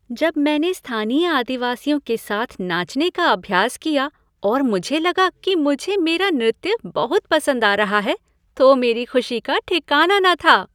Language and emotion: Hindi, happy